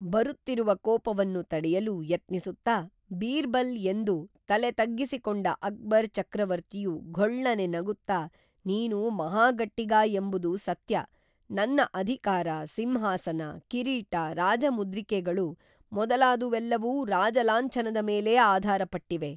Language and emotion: Kannada, neutral